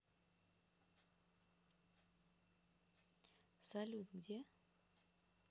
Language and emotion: Russian, neutral